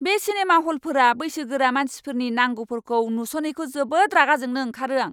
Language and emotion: Bodo, angry